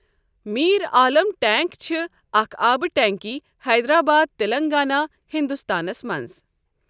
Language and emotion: Kashmiri, neutral